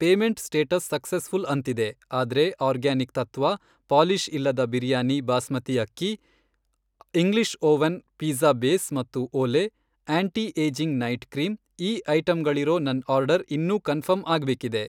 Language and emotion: Kannada, neutral